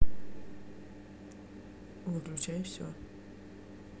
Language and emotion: Russian, neutral